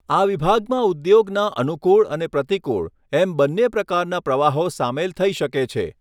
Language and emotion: Gujarati, neutral